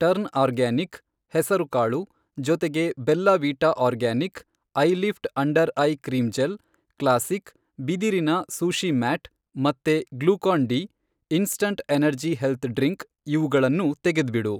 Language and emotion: Kannada, neutral